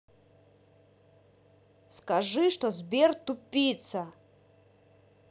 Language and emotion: Russian, angry